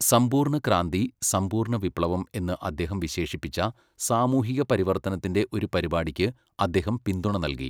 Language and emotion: Malayalam, neutral